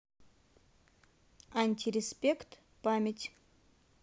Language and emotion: Russian, neutral